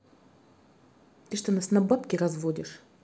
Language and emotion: Russian, angry